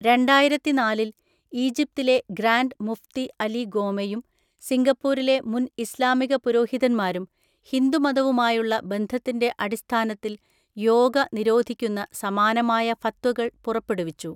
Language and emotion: Malayalam, neutral